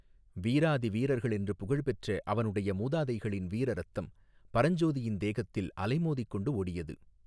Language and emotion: Tamil, neutral